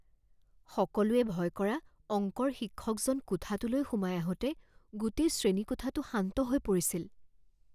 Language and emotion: Assamese, fearful